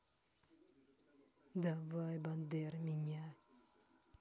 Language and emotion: Russian, neutral